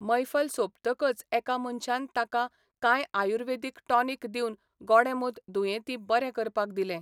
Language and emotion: Goan Konkani, neutral